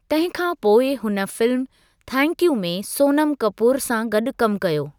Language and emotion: Sindhi, neutral